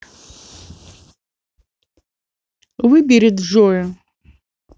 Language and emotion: Russian, neutral